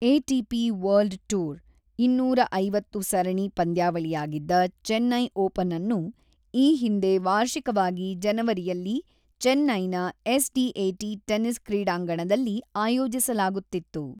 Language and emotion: Kannada, neutral